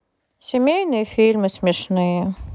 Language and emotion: Russian, neutral